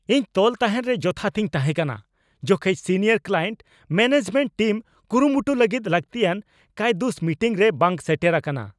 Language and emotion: Santali, angry